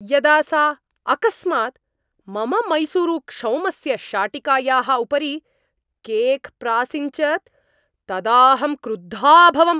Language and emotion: Sanskrit, angry